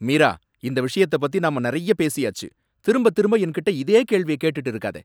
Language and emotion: Tamil, angry